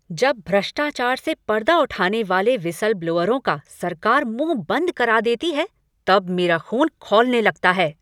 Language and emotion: Hindi, angry